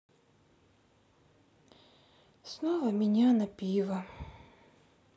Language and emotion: Russian, sad